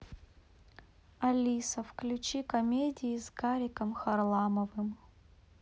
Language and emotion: Russian, neutral